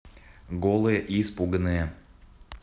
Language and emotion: Russian, neutral